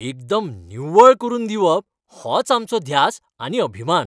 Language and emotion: Goan Konkani, happy